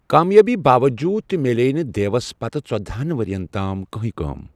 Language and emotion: Kashmiri, neutral